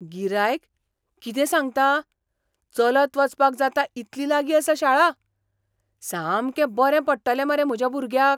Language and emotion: Goan Konkani, surprised